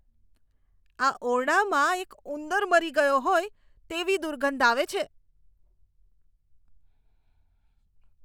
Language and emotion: Gujarati, disgusted